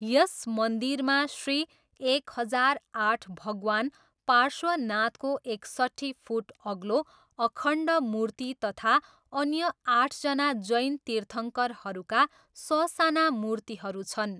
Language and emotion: Nepali, neutral